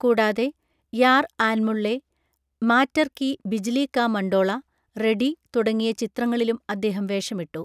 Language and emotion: Malayalam, neutral